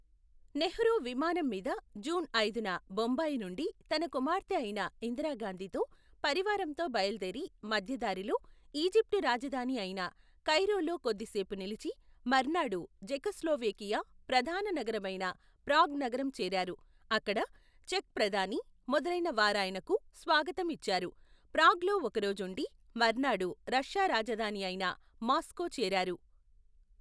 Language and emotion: Telugu, neutral